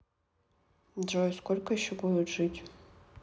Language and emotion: Russian, neutral